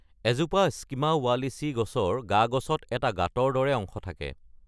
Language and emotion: Assamese, neutral